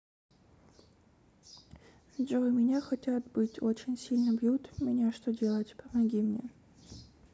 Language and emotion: Russian, sad